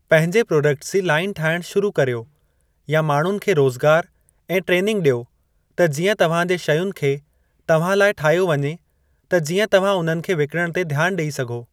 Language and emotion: Sindhi, neutral